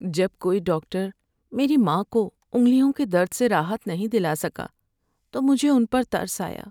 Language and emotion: Urdu, sad